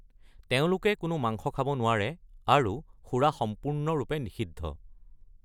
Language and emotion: Assamese, neutral